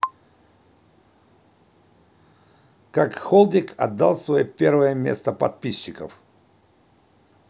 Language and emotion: Russian, neutral